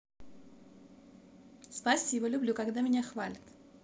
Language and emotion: Russian, positive